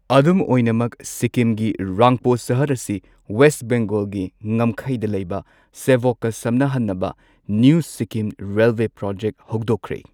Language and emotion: Manipuri, neutral